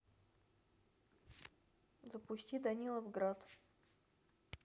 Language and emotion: Russian, neutral